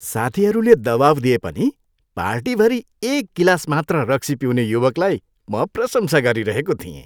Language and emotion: Nepali, happy